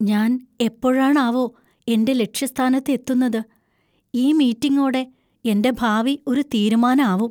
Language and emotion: Malayalam, fearful